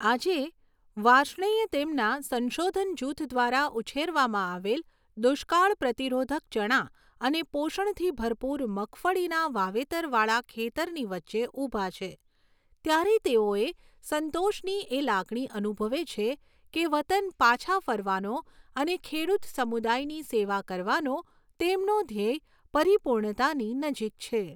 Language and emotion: Gujarati, neutral